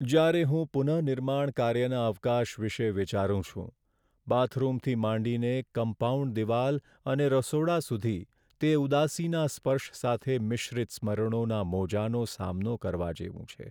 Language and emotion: Gujarati, sad